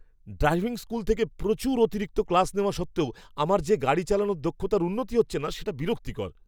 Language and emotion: Bengali, angry